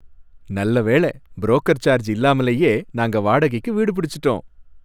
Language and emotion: Tamil, happy